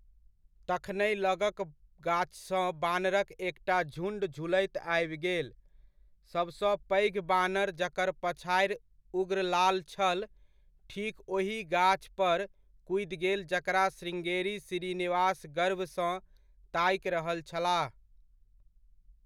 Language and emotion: Maithili, neutral